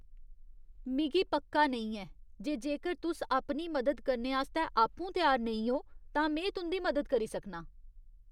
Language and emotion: Dogri, disgusted